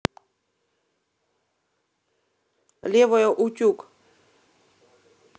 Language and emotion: Russian, neutral